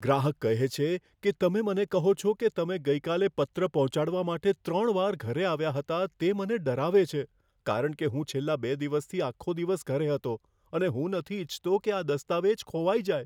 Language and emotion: Gujarati, fearful